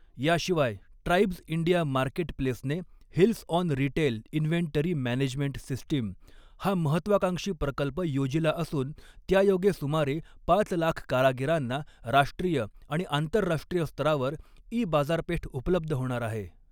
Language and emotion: Marathi, neutral